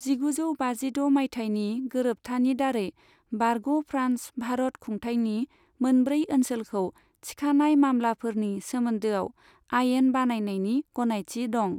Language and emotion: Bodo, neutral